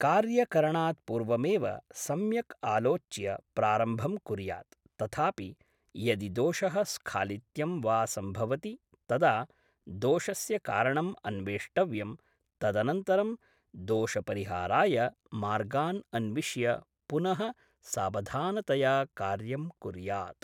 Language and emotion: Sanskrit, neutral